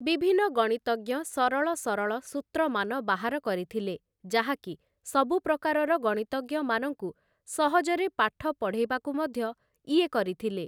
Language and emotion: Odia, neutral